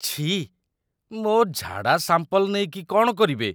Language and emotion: Odia, disgusted